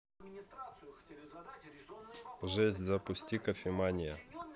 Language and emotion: Russian, neutral